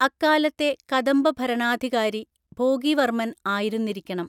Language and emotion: Malayalam, neutral